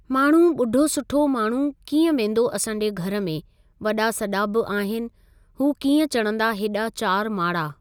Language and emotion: Sindhi, neutral